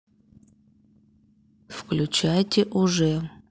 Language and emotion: Russian, neutral